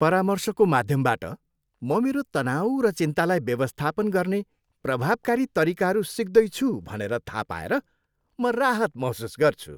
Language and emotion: Nepali, happy